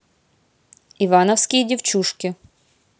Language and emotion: Russian, neutral